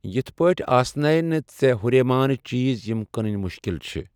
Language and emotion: Kashmiri, neutral